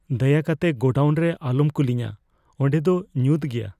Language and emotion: Santali, fearful